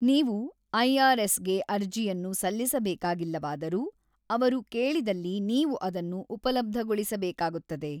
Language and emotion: Kannada, neutral